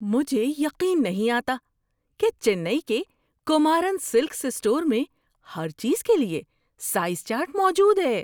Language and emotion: Urdu, surprised